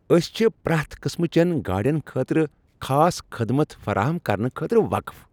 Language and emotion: Kashmiri, happy